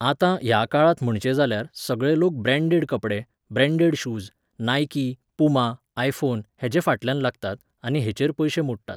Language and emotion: Goan Konkani, neutral